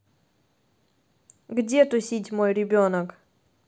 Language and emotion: Russian, neutral